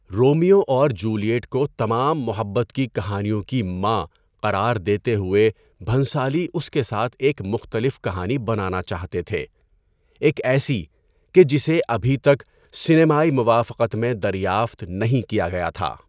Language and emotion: Urdu, neutral